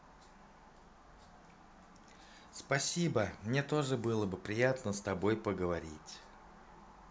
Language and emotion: Russian, positive